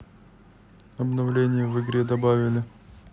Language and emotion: Russian, neutral